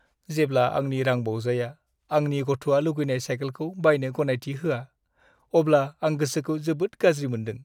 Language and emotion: Bodo, sad